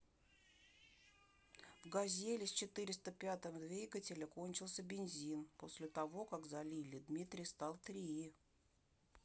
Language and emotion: Russian, neutral